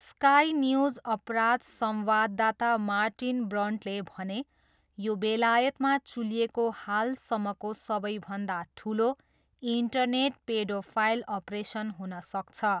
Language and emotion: Nepali, neutral